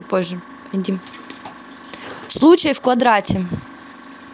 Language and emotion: Russian, neutral